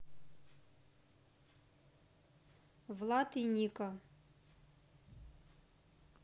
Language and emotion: Russian, neutral